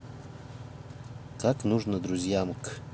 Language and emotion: Russian, neutral